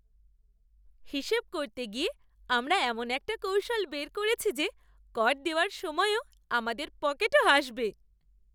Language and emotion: Bengali, happy